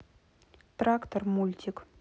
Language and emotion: Russian, neutral